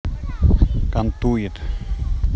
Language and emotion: Russian, neutral